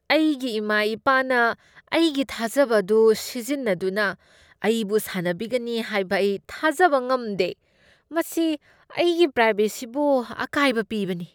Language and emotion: Manipuri, disgusted